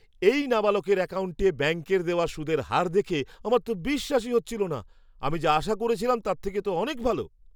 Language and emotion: Bengali, surprised